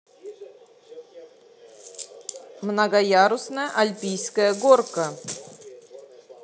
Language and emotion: Russian, positive